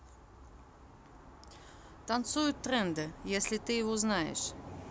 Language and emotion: Russian, neutral